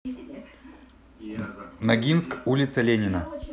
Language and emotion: Russian, neutral